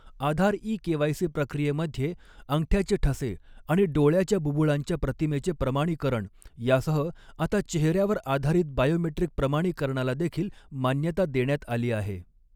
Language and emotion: Marathi, neutral